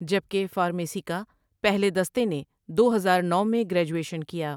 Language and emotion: Urdu, neutral